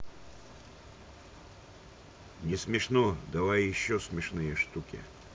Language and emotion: Russian, neutral